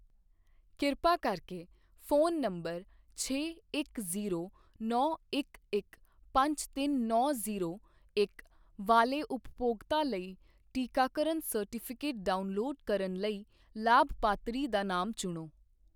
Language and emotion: Punjabi, neutral